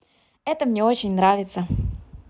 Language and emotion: Russian, positive